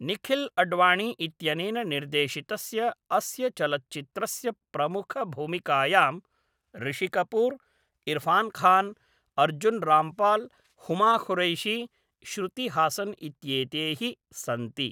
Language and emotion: Sanskrit, neutral